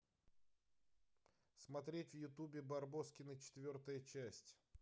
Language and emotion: Russian, neutral